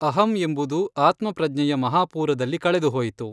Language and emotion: Kannada, neutral